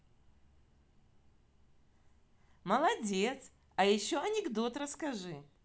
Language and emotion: Russian, positive